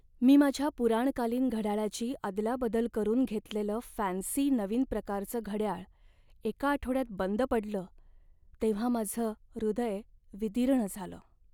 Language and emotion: Marathi, sad